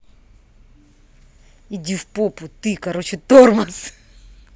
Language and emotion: Russian, angry